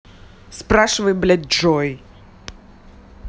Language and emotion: Russian, angry